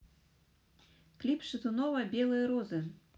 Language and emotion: Russian, neutral